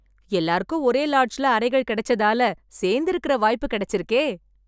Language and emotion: Tamil, happy